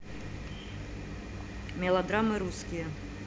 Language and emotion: Russian, neutral